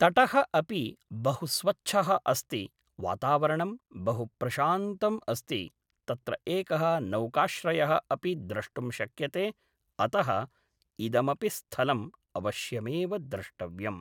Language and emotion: Sanskrit, neutral